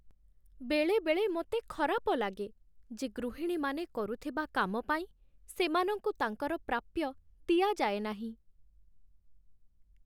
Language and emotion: Odia, sad